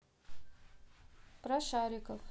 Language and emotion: Russian, neutral